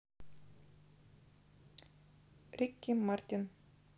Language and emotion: Russian, neutral